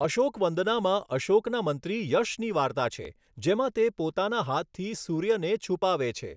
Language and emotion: Gujarati, neutral